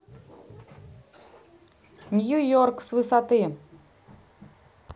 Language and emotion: Russian, neutral